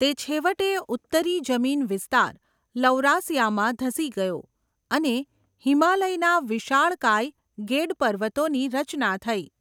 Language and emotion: Gujarati, neutral